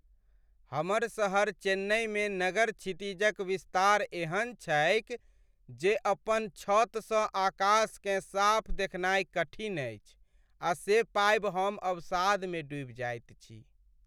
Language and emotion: Maithili, sad